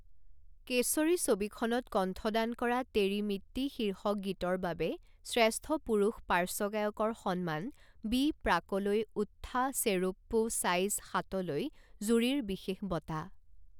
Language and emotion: Assamese, neutral